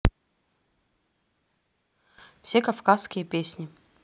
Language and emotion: Russian, neutral